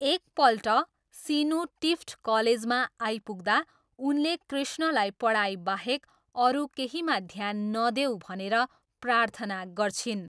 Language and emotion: Nepali, neutral